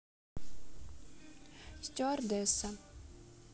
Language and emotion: Russian, neutral